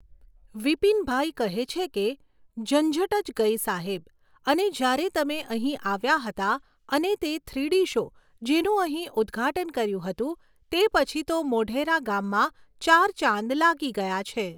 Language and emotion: Gujarati, neutral